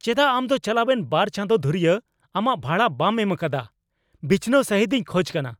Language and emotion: Santali, angry